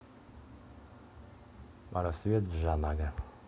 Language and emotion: Russian, neutral